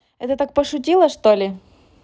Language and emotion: Russian, neutral